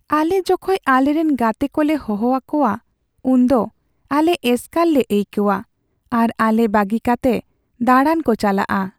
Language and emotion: Santali, sad